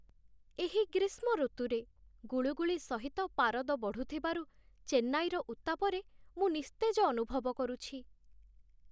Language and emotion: Odia, sad